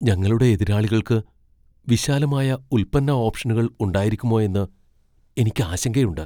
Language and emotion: Malayalam, fearful